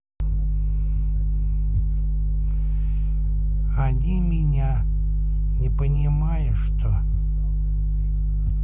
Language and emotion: Russian, sad